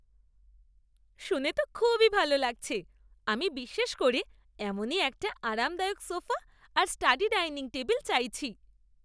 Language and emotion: Bengali, happy